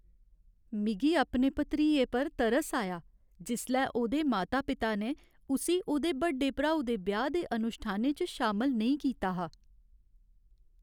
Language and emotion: Dogri, sad